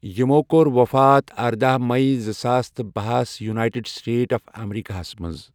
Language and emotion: Kashmiri, neutral